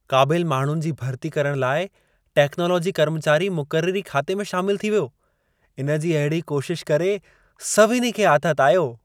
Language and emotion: Sindhi, happy